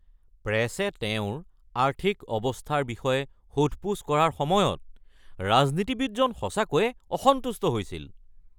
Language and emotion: Assamese, angry